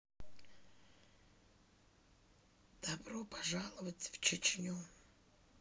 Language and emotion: Russian, neutral